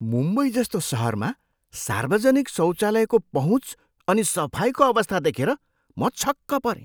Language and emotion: Nepali, surprised